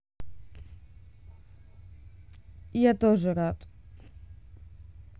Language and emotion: Russian, neutral